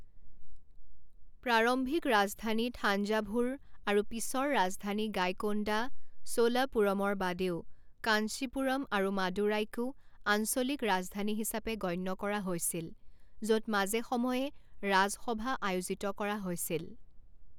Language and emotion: Assamese, neutral